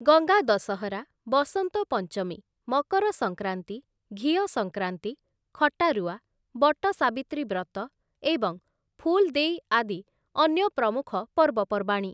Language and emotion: Odia, neutral